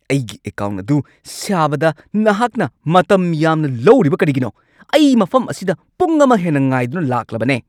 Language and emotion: Manipuri, angry